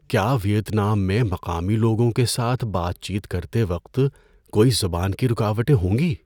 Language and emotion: Urdu, fearful